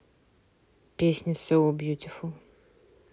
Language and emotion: Russian, neutral